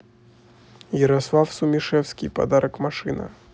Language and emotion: Russian, neutral